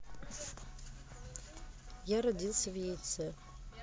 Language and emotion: Russian, neutral